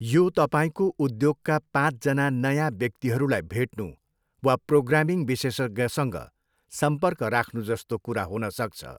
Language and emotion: Nepali, neutral